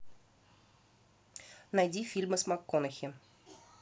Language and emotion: Russian, neutral